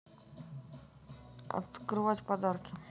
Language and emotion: Russian, neutral